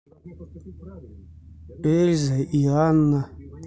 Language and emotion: Russian, neutral